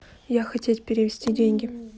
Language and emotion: Russian, neutral